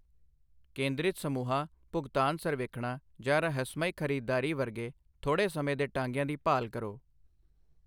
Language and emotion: Punjabi, neutral